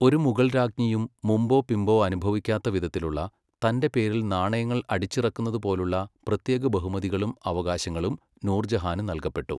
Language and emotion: Malayalam, neutral